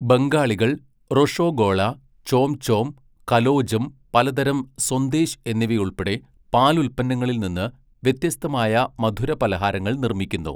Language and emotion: Malayalam, neutral